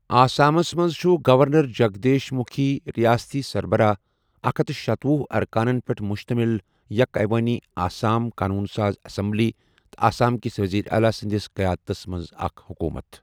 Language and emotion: Kashmiri, neutral